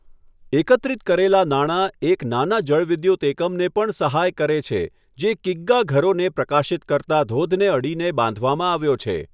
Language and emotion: Gujarati, neutral